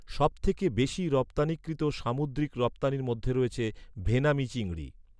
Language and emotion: Bengali, neutral